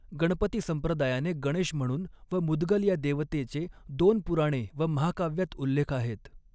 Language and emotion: Marathi, neutral